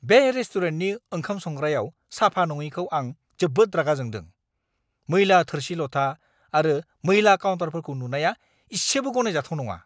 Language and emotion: Bodo, angry